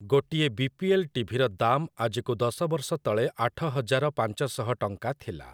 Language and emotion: Odia, neutral